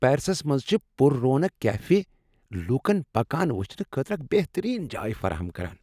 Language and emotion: Kashmiri, happy